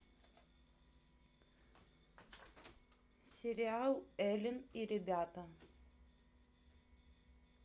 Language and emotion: Russian, neutral